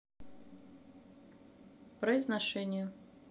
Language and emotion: Russian, neutral